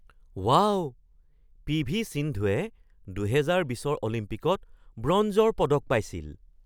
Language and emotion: Assamese, surprised